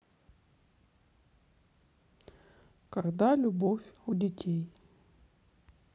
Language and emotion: Russian, neutral